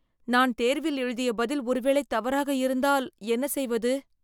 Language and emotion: Tamil, fearful